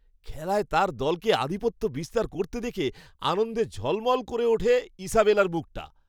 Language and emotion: Bengali, happy